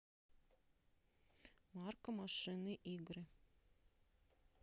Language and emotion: Russian, neutral